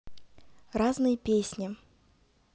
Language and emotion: Russian, positive